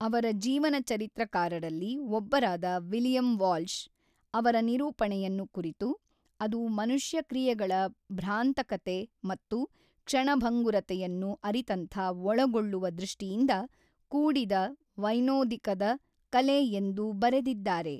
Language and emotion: Kannada, neutral